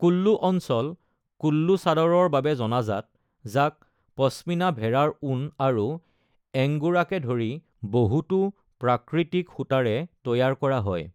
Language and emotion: Assamese, neutral